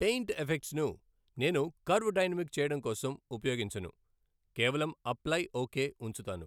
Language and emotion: Telugu, neutral